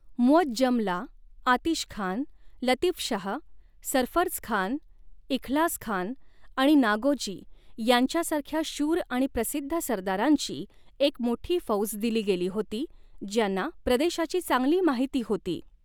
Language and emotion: Marathi, neutral